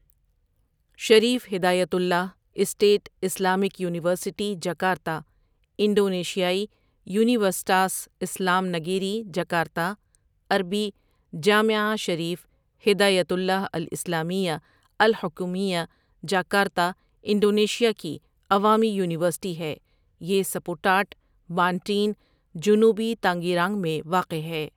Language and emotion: Urdu, neutral